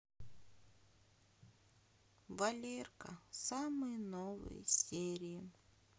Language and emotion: Russian, sad